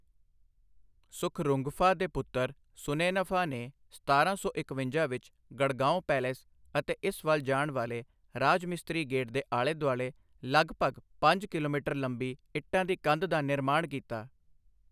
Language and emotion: Punjabi, neutral